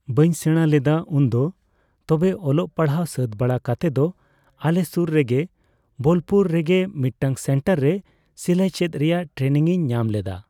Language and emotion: Santali, neutral